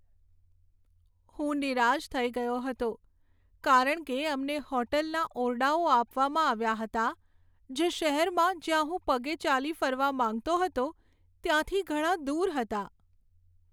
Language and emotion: Gujarati, sad